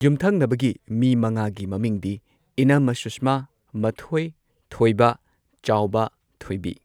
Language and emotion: Manipuri, neutral